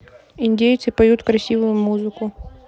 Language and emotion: Russian, neutral